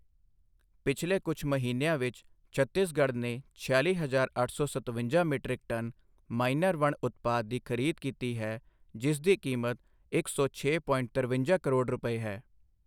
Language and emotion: Punjabi, neutral